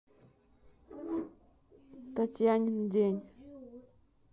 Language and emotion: Russian, neutral